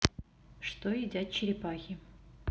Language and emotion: Russian, neutral